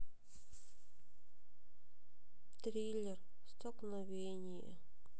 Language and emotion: Russian, sad